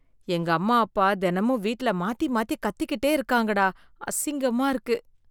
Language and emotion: Tamil, disgusted